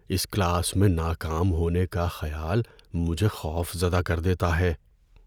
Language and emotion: Urdu, fearful